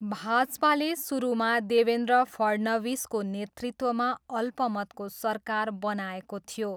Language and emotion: Nepali, neutral